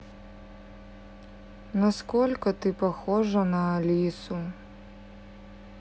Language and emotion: Russian, sad